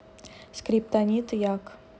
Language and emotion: Russian, neutral